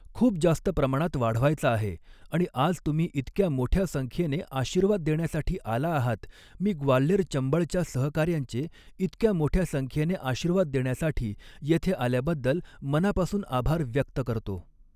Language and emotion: Marathi, neutral